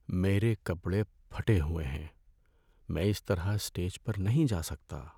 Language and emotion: Urdu, sad